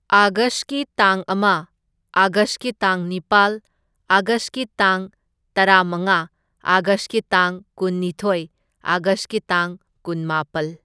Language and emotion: Manipuri, neutral